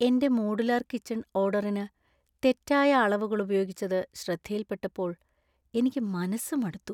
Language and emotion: Malayalam, sad